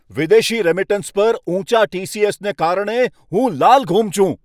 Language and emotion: Gujarati, angry